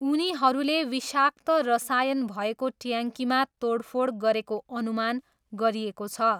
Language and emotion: Nepali, neutral